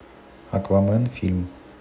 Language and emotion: Russian, neutral